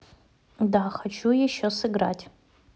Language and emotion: Russian, neutral